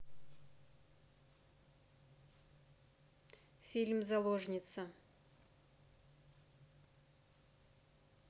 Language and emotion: Russian, neutral